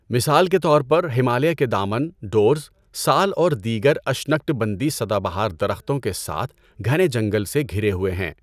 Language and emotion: Urdu, neutral